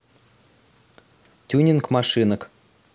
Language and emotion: Russian, neutral